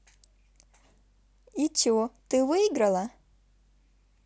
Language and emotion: Russian, positive